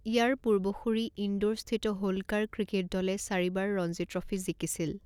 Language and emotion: Assamese, neutral